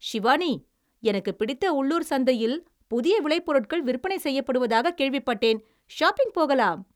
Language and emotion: Tamil, happy